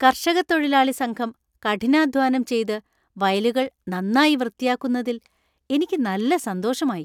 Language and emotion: Malayalam, happy